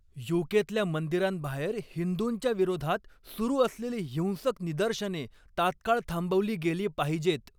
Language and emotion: Marathi, angry